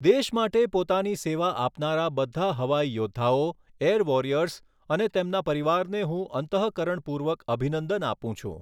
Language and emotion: Gujarati, neutral